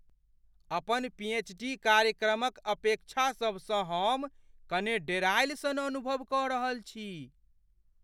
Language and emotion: Maithili, fearful